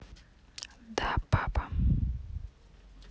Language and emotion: Russian, neutral